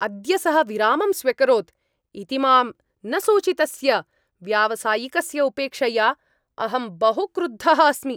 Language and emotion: Sanskrit, angry